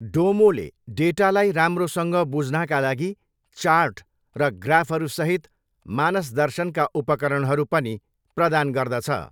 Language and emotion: Nepali, neutral